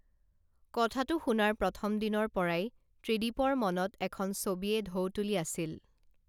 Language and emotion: Assamese, neutral